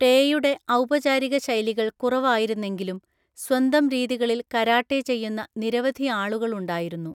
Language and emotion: Malayalam, neutral